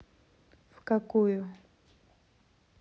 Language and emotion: Russian, neutral